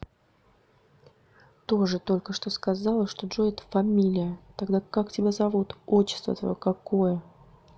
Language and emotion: Russian, neutral